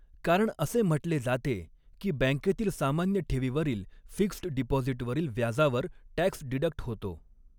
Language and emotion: Marathi, neutral